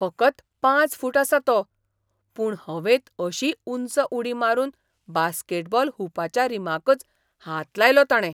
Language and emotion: Goan Konkani, surprised